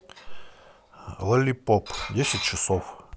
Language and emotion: Russian, neutral